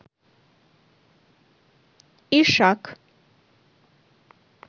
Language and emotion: Russian, neutral